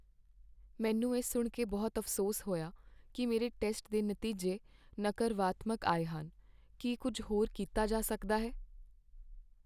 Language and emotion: Punjabi, sad